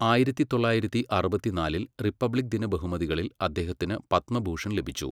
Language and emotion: Malayalam, neutral